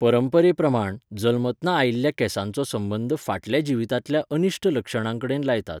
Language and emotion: Goan Konkani, neutral